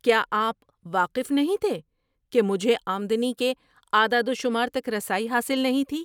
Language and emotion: Urdu, surprised